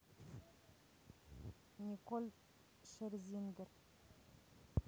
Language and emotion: Russian, neutral